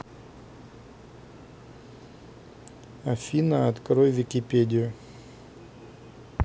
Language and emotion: Russian, neutral